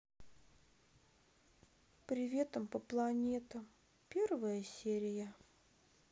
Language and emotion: Russian, sad